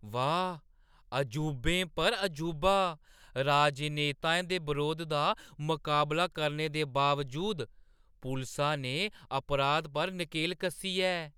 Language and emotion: Dogri, surprised